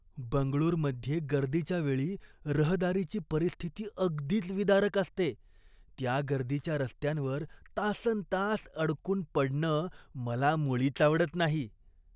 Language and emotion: Marathi, disgusted